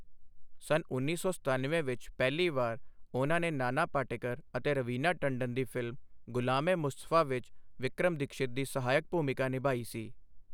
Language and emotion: Punjabi, neutral